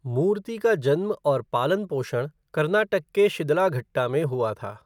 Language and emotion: Hindi, neutral